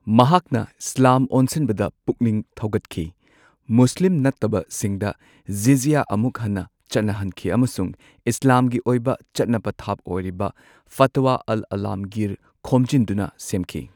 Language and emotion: Manipuri, neutral